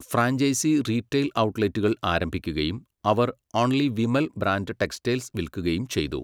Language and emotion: Malayalam, neutral